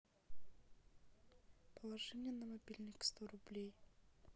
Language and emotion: Russian, sad